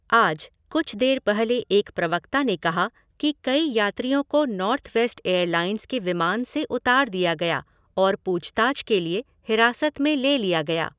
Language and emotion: Hindi, neutral